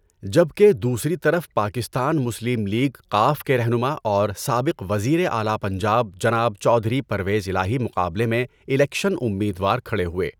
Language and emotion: Urdu, neutral